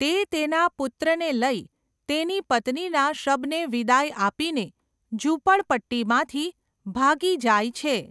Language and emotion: Gujarati, neutral